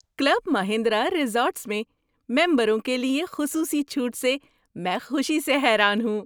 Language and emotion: Urdu, surprised